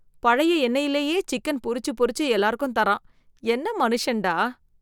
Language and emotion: Tamil, disgusted